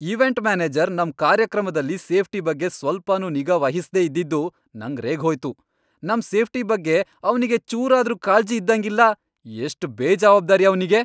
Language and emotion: Kannada, angry